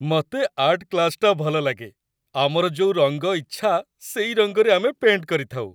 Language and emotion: Odia, happy